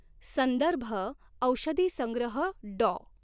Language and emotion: Marathi, neutral